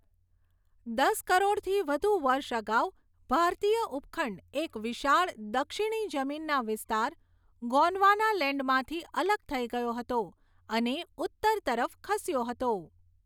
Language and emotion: Gujarati, neutral